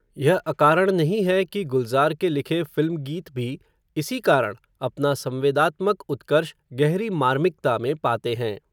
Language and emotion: Hindi, neutral